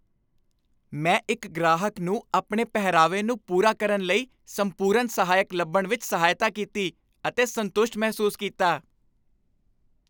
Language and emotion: Punjabi, happy